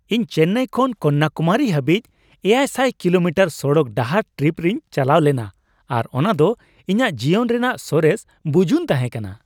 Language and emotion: Santali, happy